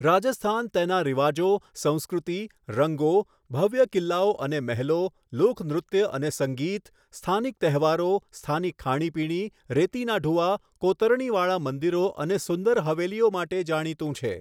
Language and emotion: Gujarati, neutral